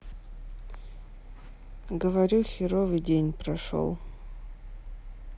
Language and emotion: Russian, sad